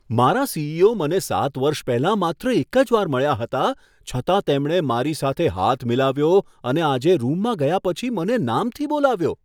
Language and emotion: Gujarati, surprised